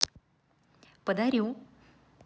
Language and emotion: Russian, positive